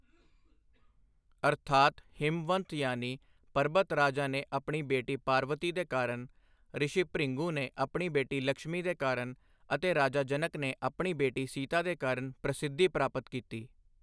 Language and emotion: Punjabi, neutral